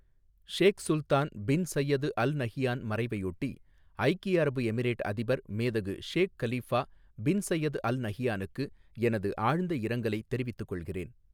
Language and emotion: Tamil, neutral